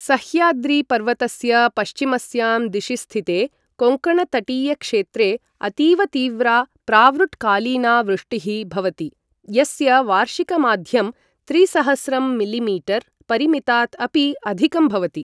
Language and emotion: Sanskrit, neutral